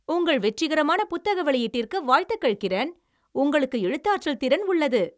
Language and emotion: Tamil, happy